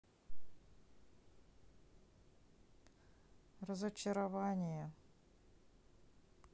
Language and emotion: Russian, sad